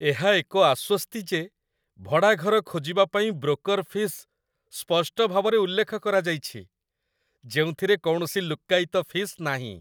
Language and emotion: Odia, happy